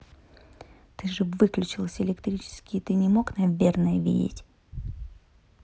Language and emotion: Russian, angry